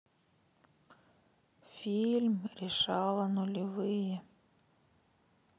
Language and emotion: Russian, sad